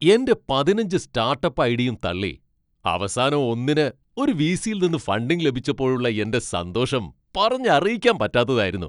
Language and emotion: Malayalam, happy